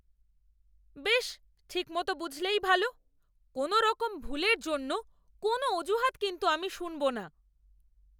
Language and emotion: Bengali, angry